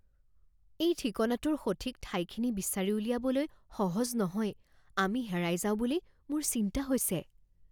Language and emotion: Assamese, fearful